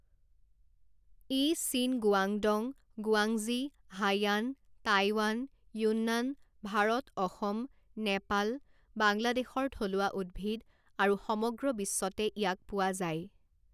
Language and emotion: Assamese, neutral